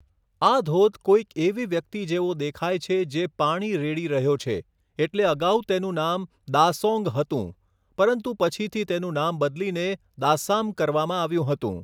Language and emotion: Gujarati, neutral